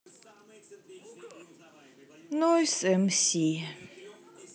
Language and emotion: Russian, sad